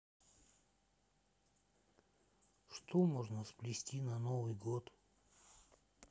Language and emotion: Russian, sad